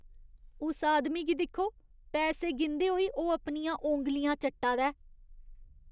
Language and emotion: Dogri, disgusted